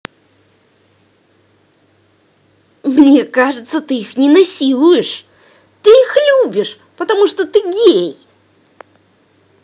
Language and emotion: Russian, angry